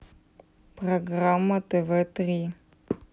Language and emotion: Russian, neutral